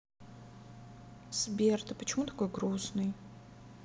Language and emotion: Russian, sad